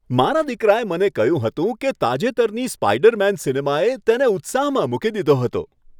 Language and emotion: Gujarati, happy